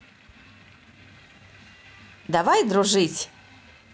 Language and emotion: Russian, positive